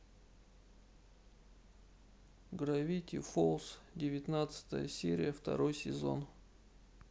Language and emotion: Russian, sad